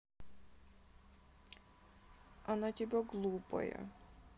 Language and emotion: Russian, sad